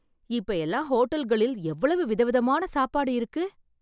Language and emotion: Tamil, surprised